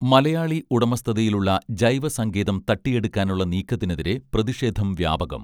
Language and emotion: Malayalam, neutral